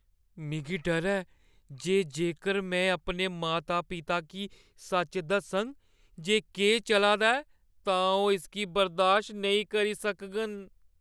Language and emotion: Dogri, fearful